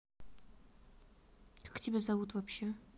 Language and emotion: Russian, neutral